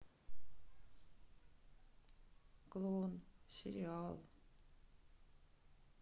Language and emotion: Russian, sad